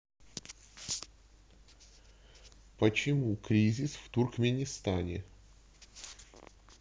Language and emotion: Russian, neutral